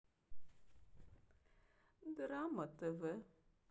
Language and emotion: Russian, sad